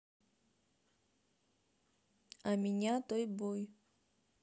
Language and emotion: Russian, neutral